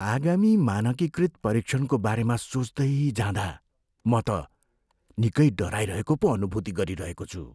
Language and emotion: Nepali, fearful